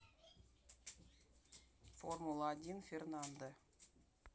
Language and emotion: Russian, neutral